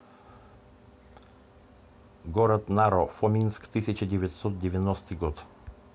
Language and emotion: Russian, neutral